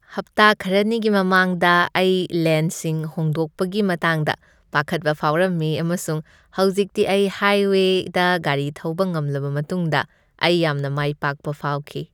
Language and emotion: Manipuri, happy